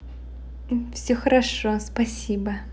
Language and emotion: Russian, positive